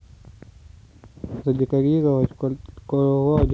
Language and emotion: Russian, neutral